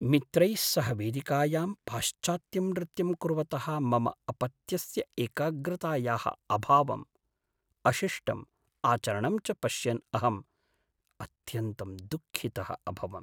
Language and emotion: Sanskrit, sad